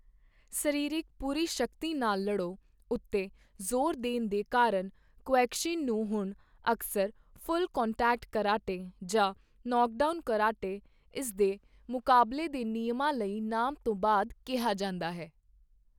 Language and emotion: Punjabi, neutral